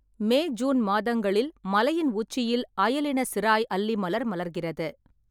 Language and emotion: Tamil, neutral